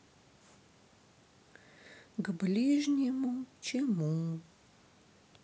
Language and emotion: Russian, sad